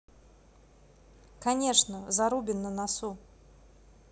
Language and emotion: Russian, neutral